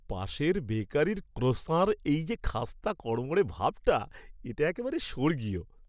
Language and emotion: Bengali, happy